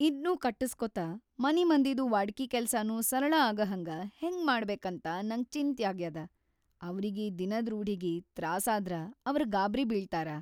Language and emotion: Kannada, fearful